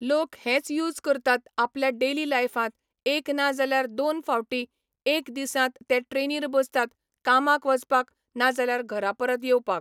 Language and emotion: Goan Konkani, neutral